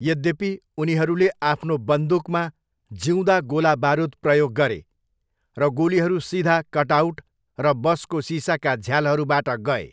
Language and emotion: Nepali, neutral